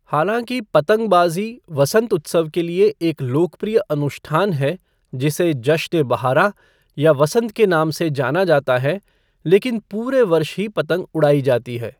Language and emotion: Hindi, neutral